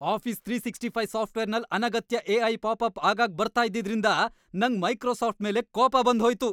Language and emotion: Kannada, angry